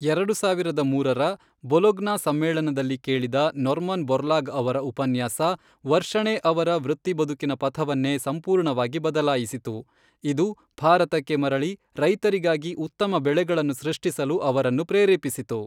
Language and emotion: Kannada, neutral